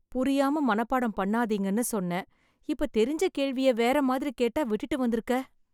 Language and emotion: Tamil, sad